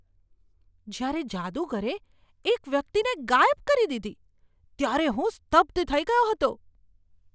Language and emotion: Gujarati, surprised